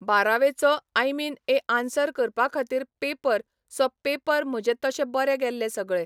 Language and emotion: Goan Konkani, neutral